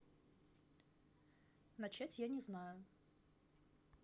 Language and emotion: Russian, neutral